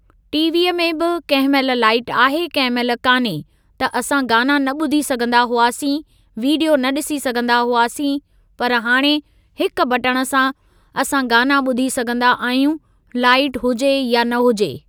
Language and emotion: Sindhi, neutral